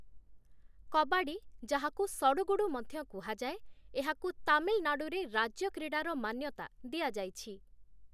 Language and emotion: Odia, neutral